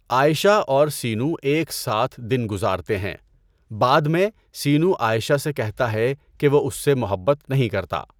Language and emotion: Urdu, neutral